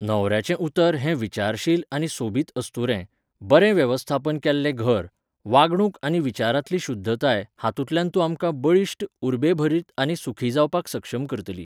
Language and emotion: Goan Konkani, neutral